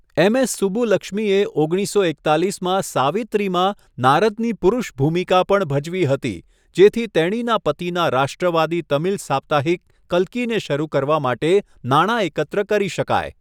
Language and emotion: Gujarati, neutral